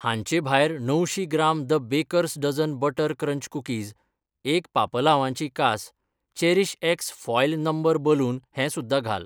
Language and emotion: Goan Konkani, neutral